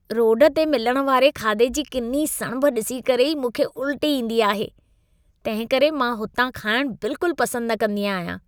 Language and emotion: Sindhi, disgusted